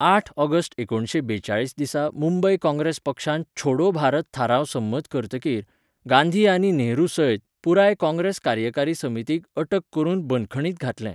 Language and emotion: Goan Konkani, neutral